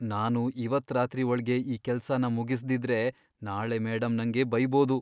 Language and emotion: Kannada, fearful